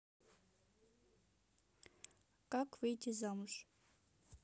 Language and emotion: Russian, neutral